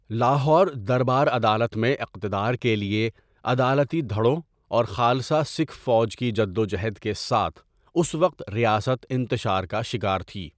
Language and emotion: Urdu, neutral